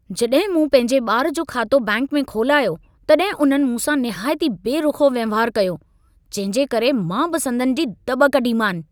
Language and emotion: Sindhi, angry